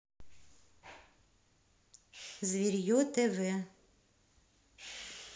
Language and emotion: Russian, neutral